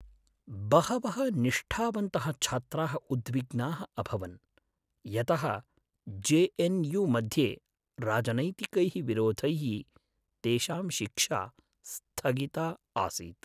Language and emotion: Sanskrit, sad